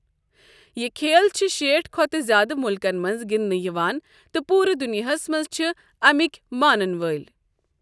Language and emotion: Kashmiri, neutral